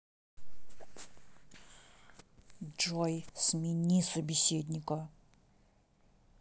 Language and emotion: Russian, angry